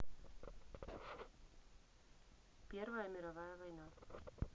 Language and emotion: Russian, neutral